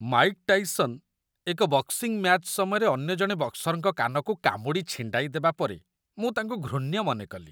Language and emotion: Odia, disgusted